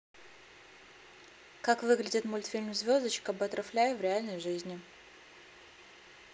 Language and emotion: Russian, neutral